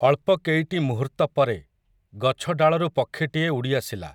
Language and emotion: Odia, neutral